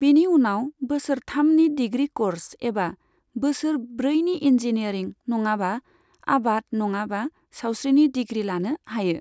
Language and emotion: Bodo, neutral